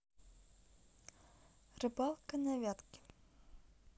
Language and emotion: Russian, neutral